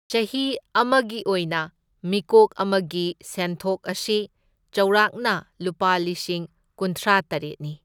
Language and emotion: Manipuri, neutral